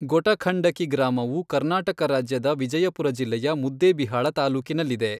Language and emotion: Kannada, neutral